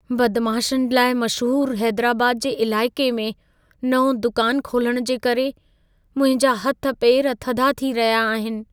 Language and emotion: Sindhi, fearful